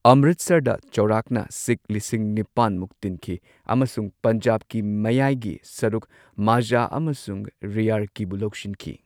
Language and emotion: Manipuri, neutral